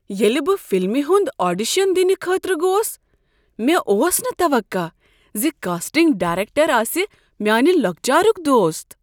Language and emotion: Kashmiri, surprised